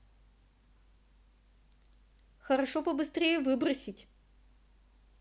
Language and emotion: Russian, neutral